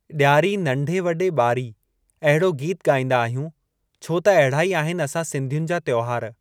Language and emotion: Sindhi, neutral